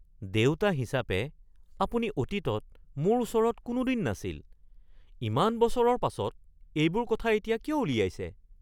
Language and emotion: Assamese, surprised